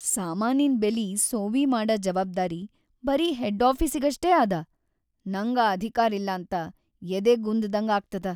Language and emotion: Kannada, sad